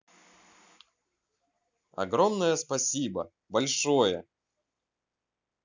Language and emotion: Russian, positive